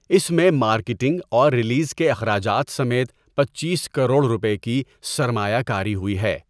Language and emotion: Urdu, neutral